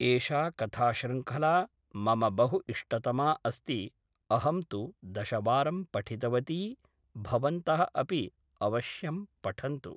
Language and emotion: Sanskrit, neutral